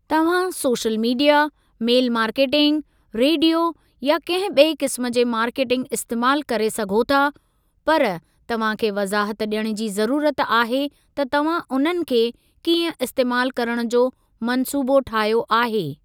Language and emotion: Sindhi, neutral